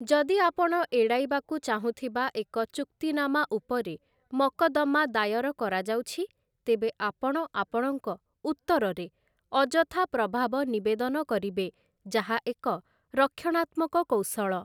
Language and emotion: Odia, neutral